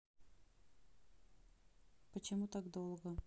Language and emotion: Russian, neutral